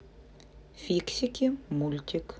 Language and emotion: Russian, neutral